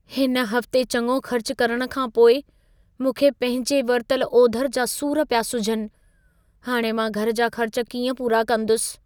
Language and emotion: Sindhi, fearful